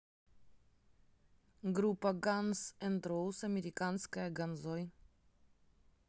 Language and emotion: Russian, neutral